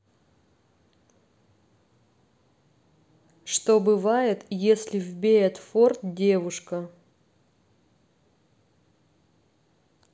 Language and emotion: Russian, neutral